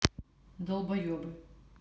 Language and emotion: Russian, neutral